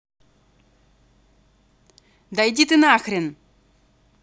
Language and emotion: Russian, angry